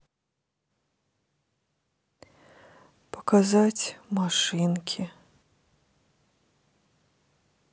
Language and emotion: Russian, sad